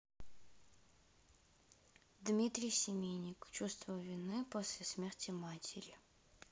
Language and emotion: Russian, sad